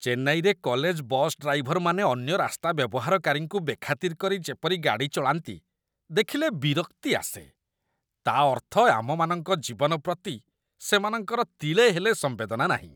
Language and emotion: Odia, disgusted